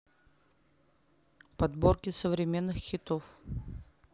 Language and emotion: Russian, neutral